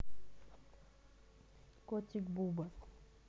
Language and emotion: Russian, neutral